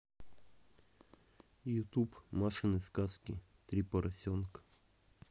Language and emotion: Russian, neutral